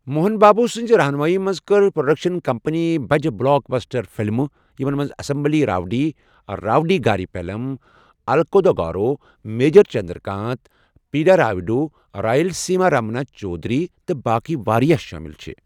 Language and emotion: Kashmiri, neutral